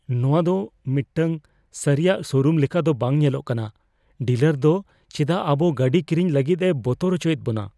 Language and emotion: Santali, fearful